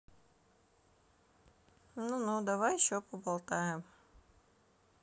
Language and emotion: Russian, neutral